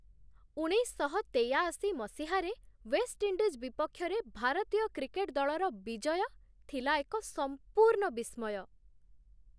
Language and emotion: Odia, surprised